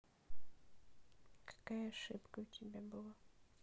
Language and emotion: Russian, sad